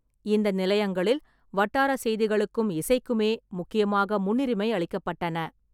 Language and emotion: Tamil, neutral